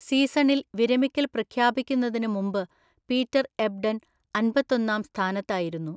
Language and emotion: Malayalam, neutral